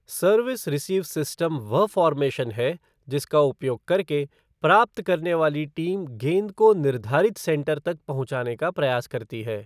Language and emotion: Hindi, neutral